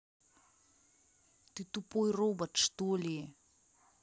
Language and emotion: Russian, angry